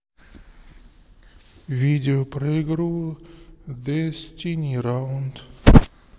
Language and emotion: Russian, sad